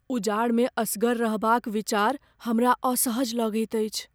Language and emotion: Maithili, fearful